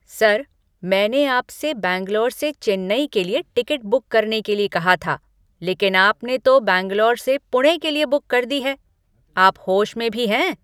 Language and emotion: Hindi, angry